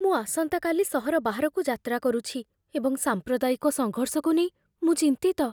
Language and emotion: Odia, fearful